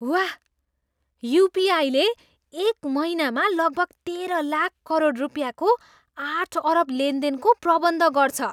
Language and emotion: Nepali, surprised